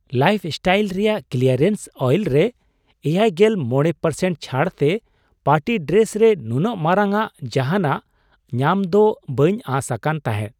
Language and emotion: Santali, surprised